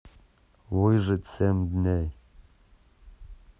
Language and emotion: Russian, neutral